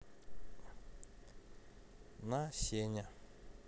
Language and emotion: Russian, neutral